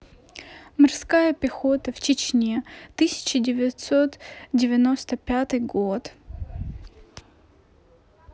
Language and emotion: Russian, neutral